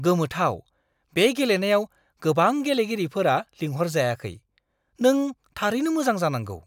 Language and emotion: Bodo, surprised